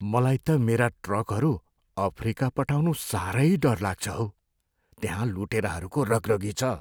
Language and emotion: Nepali, fearful